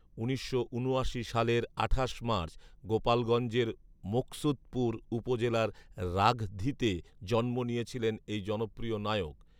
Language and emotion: Bengali, neutral